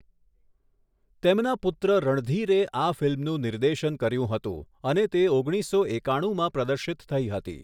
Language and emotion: Gujarati, neutral